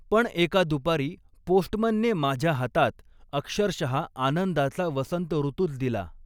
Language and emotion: Marathi, neutral